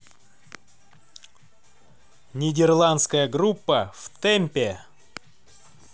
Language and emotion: Russian, positive